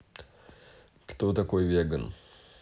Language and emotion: Russian, neutral